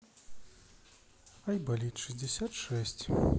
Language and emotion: Russian, sad